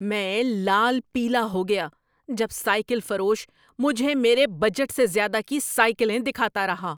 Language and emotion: Urdu, angry